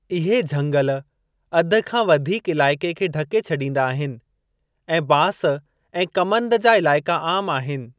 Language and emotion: Sindhi, neutral